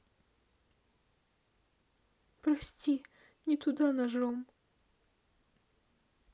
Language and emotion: Russian, sad